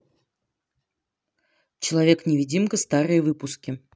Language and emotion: Russian, neutral